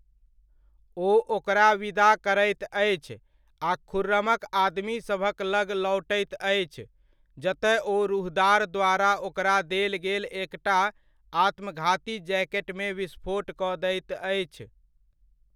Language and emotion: Maithili, neutral